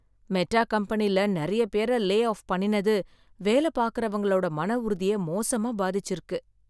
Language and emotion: Tamil, sad